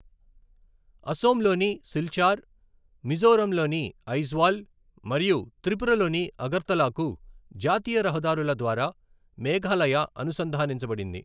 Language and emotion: Telugu, neutral